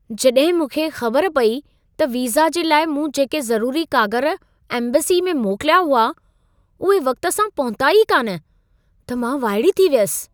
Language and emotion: Sindhi, surprised